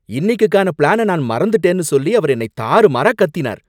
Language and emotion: Tamil, angry